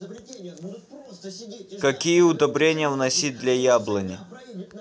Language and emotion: Russian, neutral